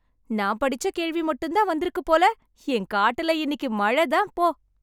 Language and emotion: Tamil, happy